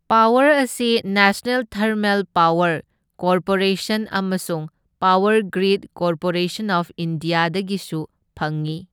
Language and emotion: Manipuri, neutral